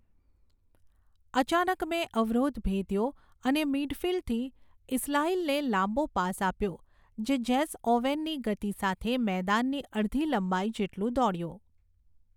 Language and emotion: Gujarati, neutral